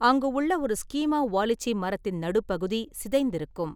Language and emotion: Tamil, neutral